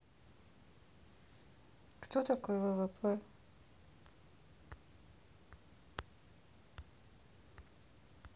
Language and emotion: Russian, neutral